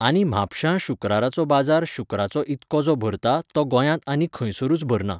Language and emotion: Goan Konkani, neutral